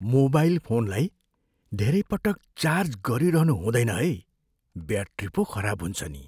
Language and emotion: Nepali, fearful